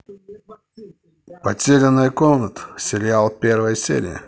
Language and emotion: Russian, positive